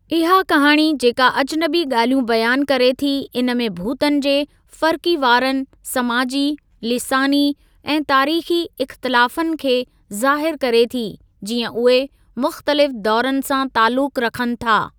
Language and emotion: Sindhi, neutral